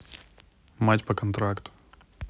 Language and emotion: Russian, neutral